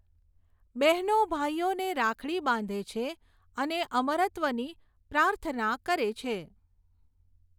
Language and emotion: Gujarati, neutral